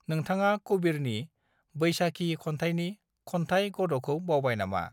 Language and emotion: Bodo, neutral